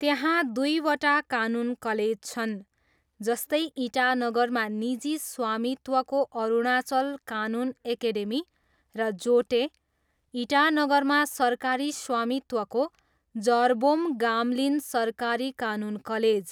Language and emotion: Nepali, neutral